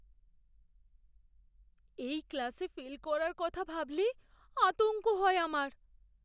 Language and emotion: Bengali, fearful